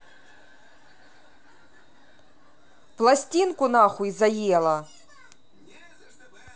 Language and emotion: Russian, angry